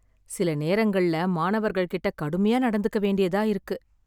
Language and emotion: Tamil, sad